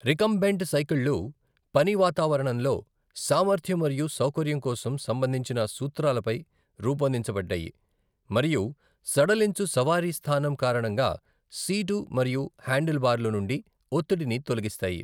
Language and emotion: Telugu, neutral